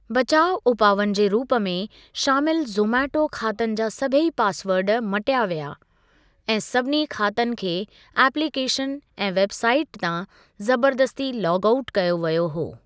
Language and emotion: Sindhi, neutral